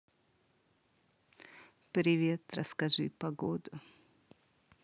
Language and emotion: Russian, neutral